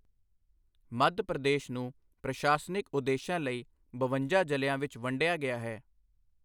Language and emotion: Punjabi, neutral